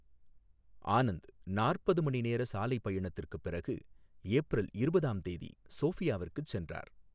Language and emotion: Tamil, neutral